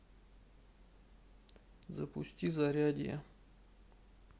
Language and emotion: Russian, sad